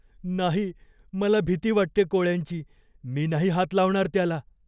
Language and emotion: Marathi, fearful